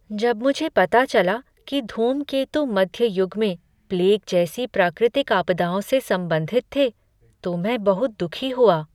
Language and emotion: Hindi, sad